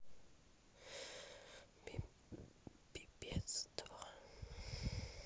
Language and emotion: Russian, sad